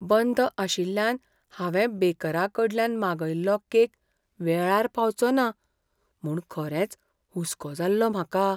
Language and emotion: Goan Konkani, fearful